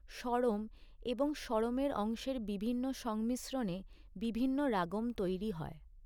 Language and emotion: Bengali, neutral